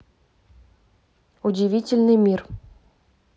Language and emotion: Russian, neutral